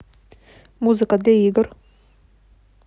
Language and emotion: Russian, neutral